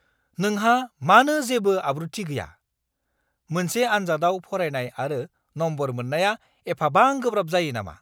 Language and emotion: Bodo, angry